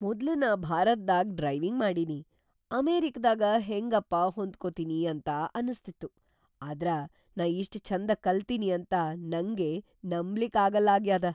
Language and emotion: Kannada, surprised